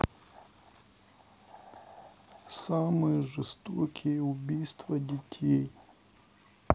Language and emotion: Russian, neutral